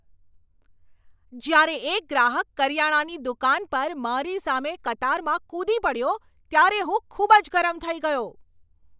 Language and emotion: Gujarati, angry